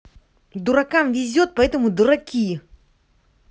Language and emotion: Russian, angry